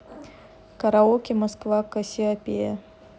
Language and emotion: Russian, neutral